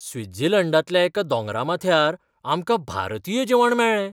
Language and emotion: Goan Konkani, surprised